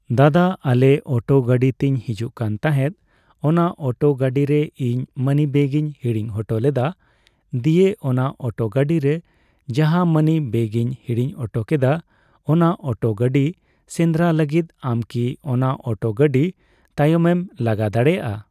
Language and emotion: Santali, neutral